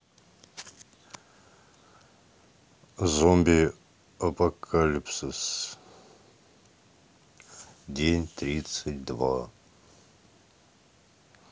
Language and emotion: Russian, neutral